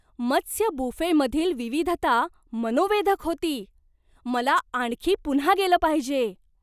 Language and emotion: Marathi, surprised